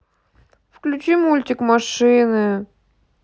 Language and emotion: Russian, sad